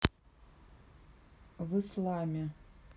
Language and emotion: Russian, neutral